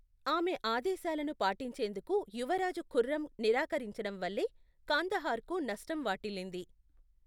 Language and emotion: Telugu, neutral